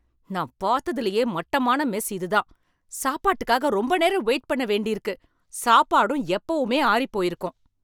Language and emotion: Tamil, angry